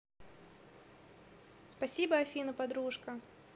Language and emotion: Russian, positive